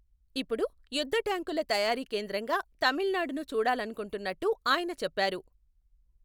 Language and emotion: Telugu, neutral